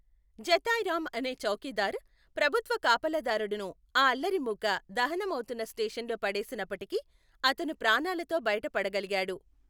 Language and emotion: Telugu, neutral